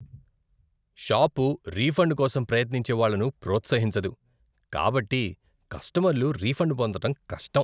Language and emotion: Telugu, disgusted